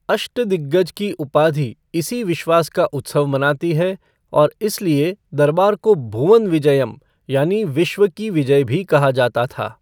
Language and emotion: Hindi, neutral